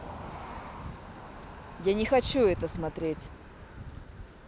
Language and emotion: Russian, angry